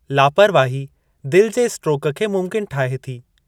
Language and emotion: Sindhi, neutral